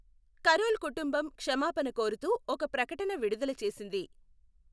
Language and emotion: Telugu, neutral